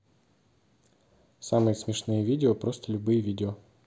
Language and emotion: Russian, neutral